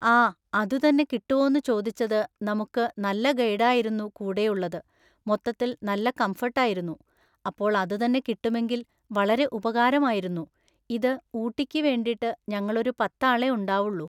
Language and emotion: Malayalam, neutral